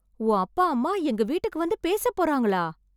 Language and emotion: Tamil, surprised